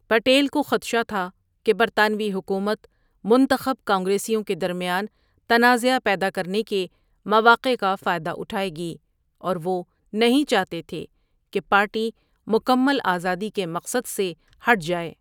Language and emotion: Urdu, neutral